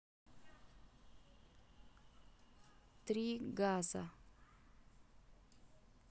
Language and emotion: Russian, neutral